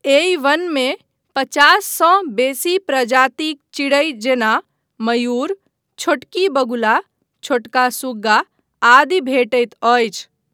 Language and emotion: Maithili, neutral